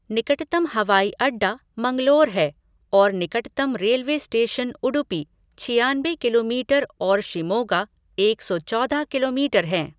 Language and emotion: Hindi, neutral